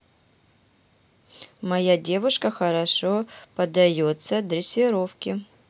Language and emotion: Russian, neutral